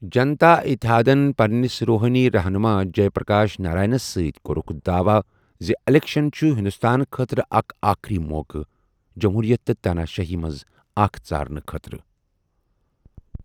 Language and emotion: Kashmiri, neutral